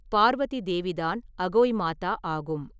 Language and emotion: Tamil, neutral